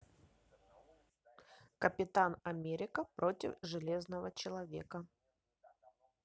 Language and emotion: Russian, neutral